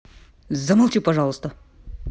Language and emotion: Russian, angry